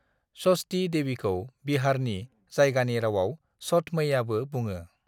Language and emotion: Bodo, neutral